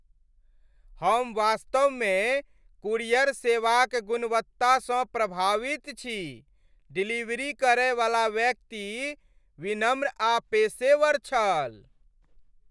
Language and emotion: Maithili, happy